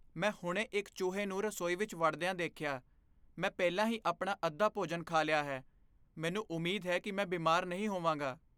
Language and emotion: Punjabi, fearful